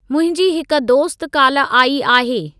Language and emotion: Sindhi, neutral